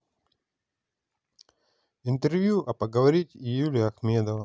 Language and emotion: Russian, neutral